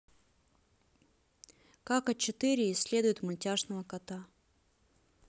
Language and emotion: Russian, neutral